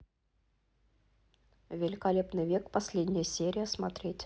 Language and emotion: Russian, neutral